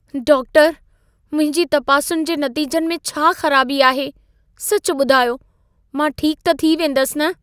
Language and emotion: Sindhi, fearful